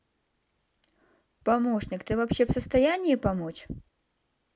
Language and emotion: Russian, neutral